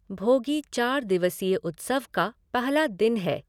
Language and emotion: Hindi, neutral